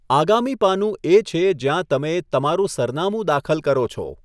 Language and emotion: Gujarati, neutral